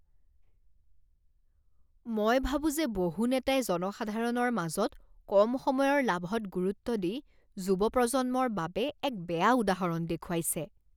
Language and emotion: Assamese, disgusted